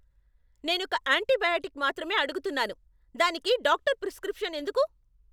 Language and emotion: Telugu, angry